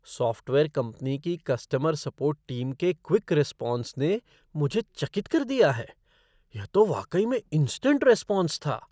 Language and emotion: Hindi, surprised